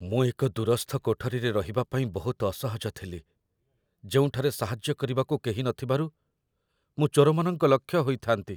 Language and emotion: Odia, fearful